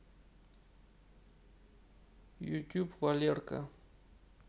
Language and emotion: Russian, neutral